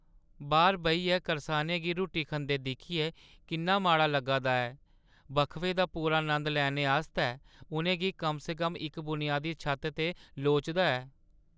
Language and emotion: Dogri, sad